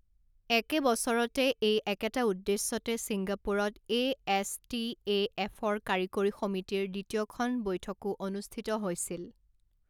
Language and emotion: Assamese, neutral